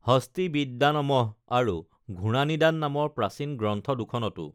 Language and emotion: Assamese, neutral